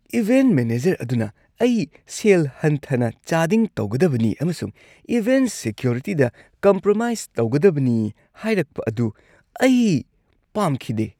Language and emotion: Manipuri, disgusted